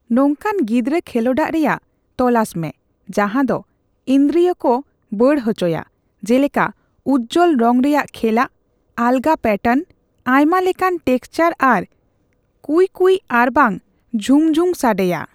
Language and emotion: Santali, neutral